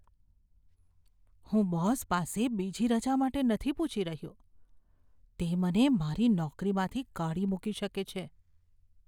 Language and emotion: Gujarati, fearful